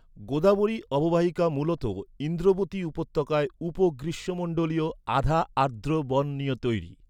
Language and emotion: Bengali, neutral